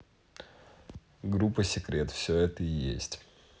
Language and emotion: Russian, neutral